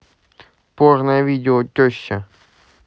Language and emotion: Russian, neutral